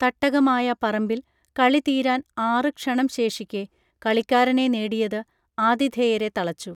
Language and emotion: Malayalam, neutral